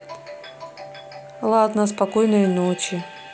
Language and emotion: Russian, neutral